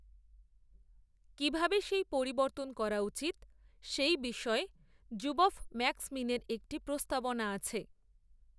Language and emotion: Bengali, neutral